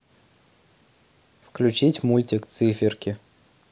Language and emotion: Russian, neutral